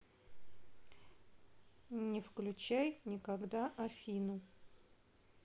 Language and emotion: Russian, neutral